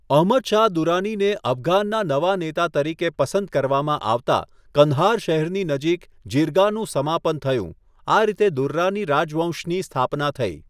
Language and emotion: Gujarati, neutral